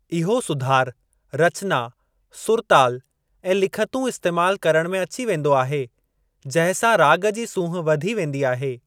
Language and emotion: Sindhi, neutral